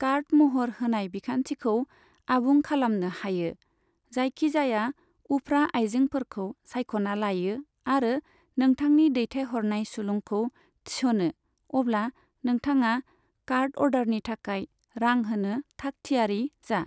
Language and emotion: Bodo, neutral